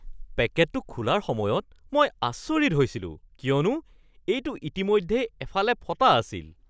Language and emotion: Assamese, surprised